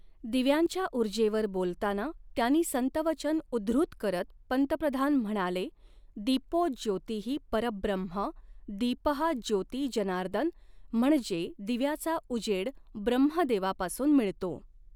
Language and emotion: Marathi, neutral